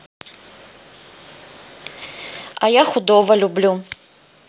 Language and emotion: Russian, neutral